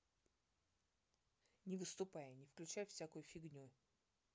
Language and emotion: Russian, angry